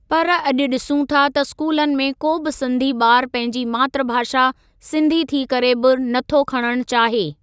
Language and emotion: Sindhi, neutral